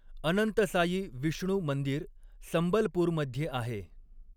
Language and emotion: Marathi, neutral